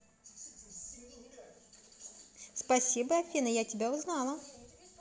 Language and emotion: Russian, positive